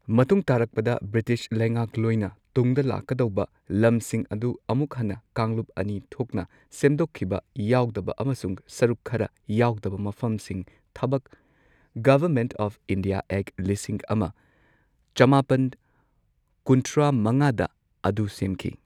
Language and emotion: Manipuri, neutral